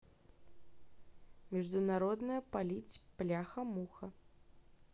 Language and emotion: Russian, neutral